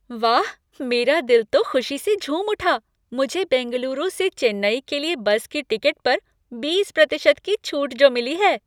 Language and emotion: Hindi, happy